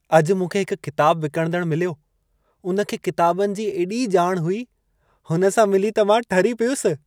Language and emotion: Sindhi, happy